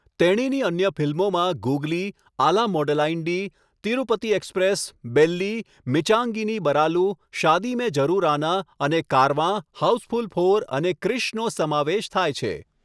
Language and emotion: Gujarati, neutral